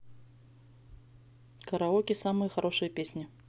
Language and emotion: Russian, neutral